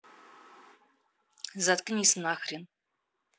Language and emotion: Russian, angry